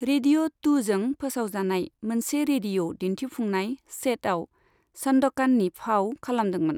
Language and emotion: Bodo, neutral